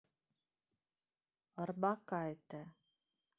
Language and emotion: Russian, neutral